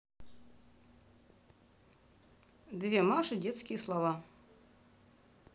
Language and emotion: Russian, neutral